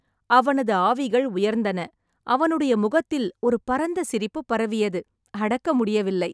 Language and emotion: Tamil, happy